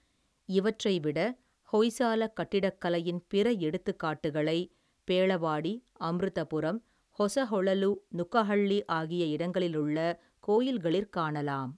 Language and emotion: Tamil, neutral